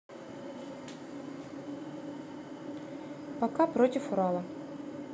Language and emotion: Russian, neutral